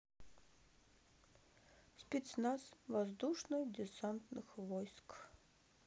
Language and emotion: Russian, neutral